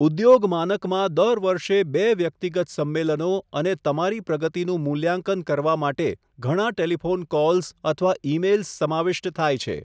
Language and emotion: Gujarati, neutral